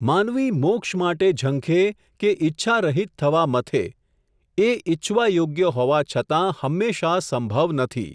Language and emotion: Gujarati, neutral